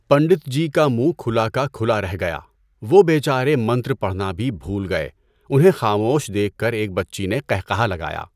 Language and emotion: Urdu, neutral